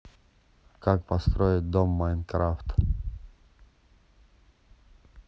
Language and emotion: Russian, neutral